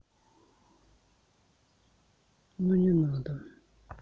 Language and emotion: Russian, sad